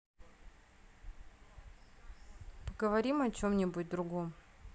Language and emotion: Russian, neutral